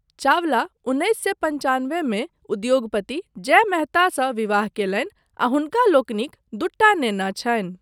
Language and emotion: Maithili, neutral